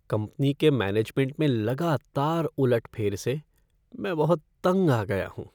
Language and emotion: Hindi, sad